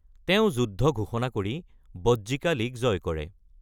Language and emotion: Assamese, neutral